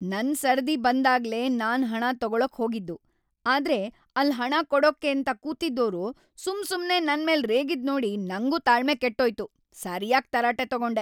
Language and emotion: Kannada, angry